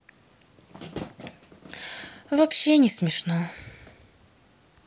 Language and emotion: Russian, sad